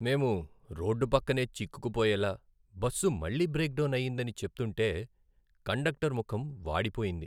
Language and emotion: Telugu, sad